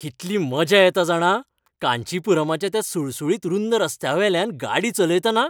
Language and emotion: Goan Konkani, happy